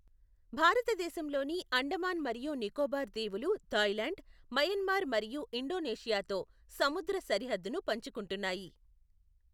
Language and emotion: Telugu, neutral